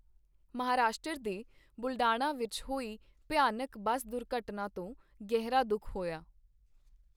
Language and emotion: Punjabi, neutral